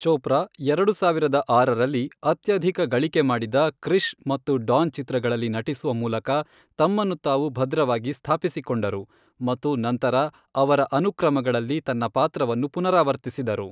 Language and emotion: Kannada, neutral